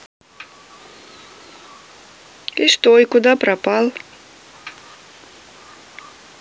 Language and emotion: Russian, neutral